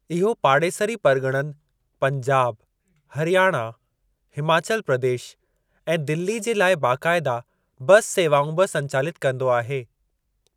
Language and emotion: Sindhi, neutral